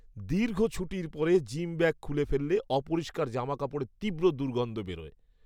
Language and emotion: Bengali, disgusted